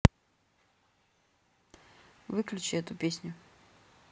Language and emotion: Russian, neutral